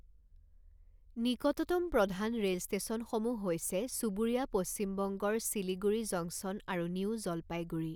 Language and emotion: Assamese, neutral